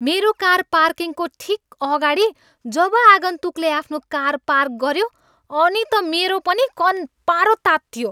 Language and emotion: Nepali, angry